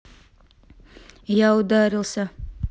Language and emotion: Russian, neutral